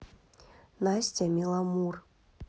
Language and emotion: Russian, neutral